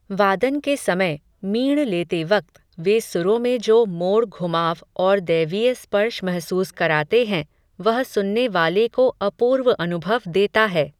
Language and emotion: Hindi, neutral